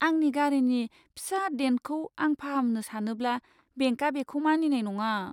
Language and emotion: Bodo, fearful